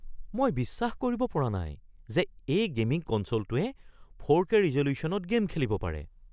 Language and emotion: Assamese, surprised